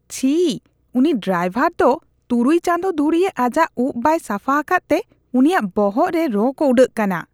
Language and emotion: Santali, disgusted